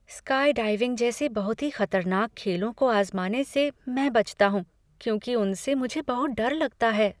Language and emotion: Hindi, fearful